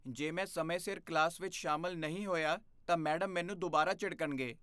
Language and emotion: Punjabi, fearful